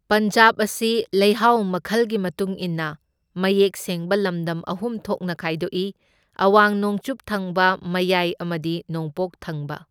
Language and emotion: Manipuri, neutral